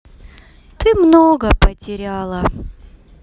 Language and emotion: Russian, sad